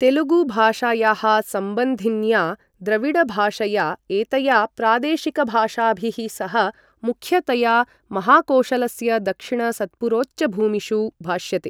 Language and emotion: Sanskrit, neutral